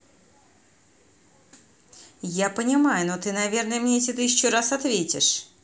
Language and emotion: Russian, neutral